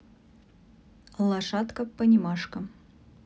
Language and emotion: Russian, neutral